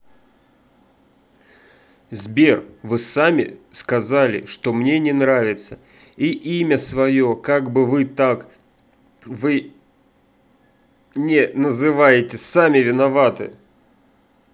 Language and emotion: Russian, angry